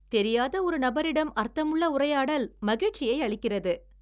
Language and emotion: Tamil, happy